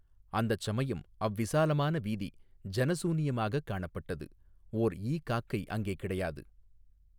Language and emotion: Tamil, neutral